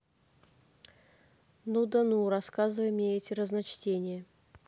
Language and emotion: Russian, neutral